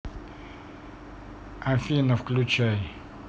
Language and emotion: Russian, neutral